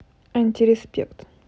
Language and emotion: Russian, neutral